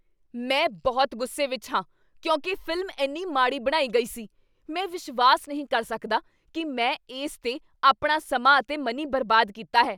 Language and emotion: Punjabi, angry